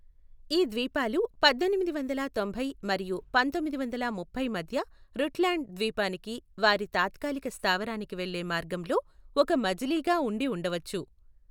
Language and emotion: Telugu, neutral